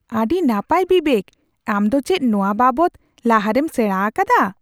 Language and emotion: Santali, surprised